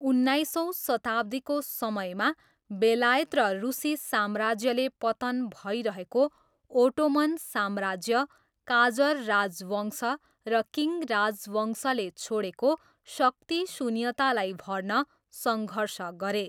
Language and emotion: Nepali, neutral